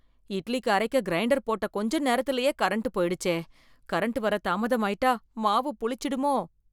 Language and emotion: Tamil, fearful